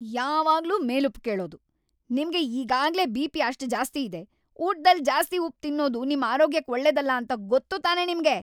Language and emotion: Kannada, angry